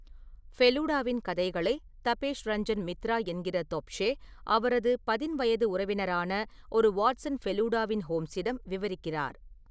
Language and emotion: Tamil, neutral